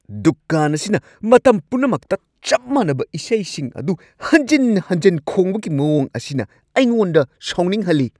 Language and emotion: Manipuri, angry